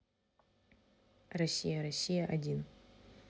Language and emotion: Russian, neutral